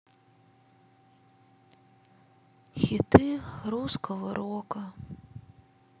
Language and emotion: Russian, sad